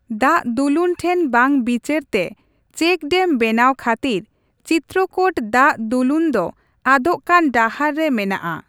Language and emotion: Santali, neutral